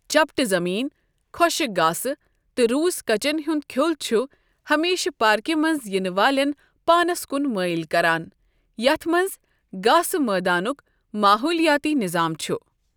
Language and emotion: Kashmiri, neutral